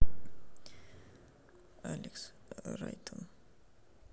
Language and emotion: Russian, sad